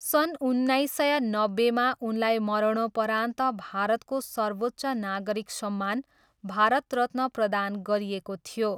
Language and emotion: Nepali, neutral